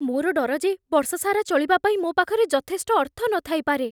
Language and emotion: Odia, fearful